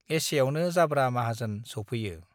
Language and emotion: Bodo, neutral